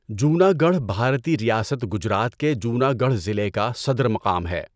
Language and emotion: Urdu, neutral